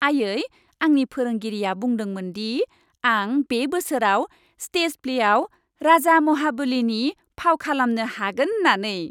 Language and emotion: Bodo, happy